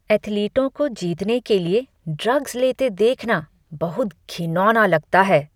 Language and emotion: Hindi, disgusted